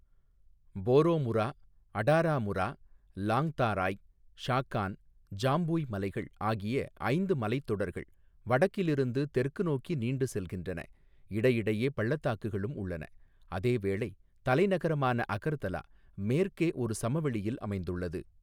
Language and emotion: Tamil, neutral